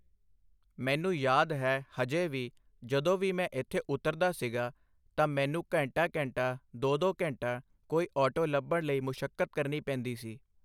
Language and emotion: Punjabi, neutral